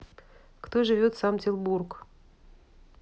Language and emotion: Russian, neutral